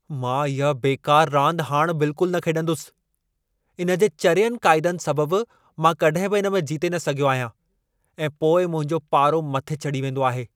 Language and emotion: Sindhi, angry